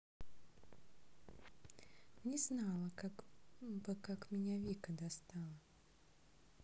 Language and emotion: Russian, neutral